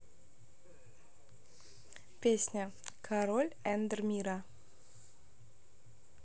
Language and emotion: Russian, neutral